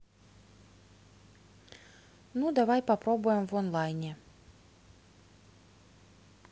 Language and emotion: Russian, neutral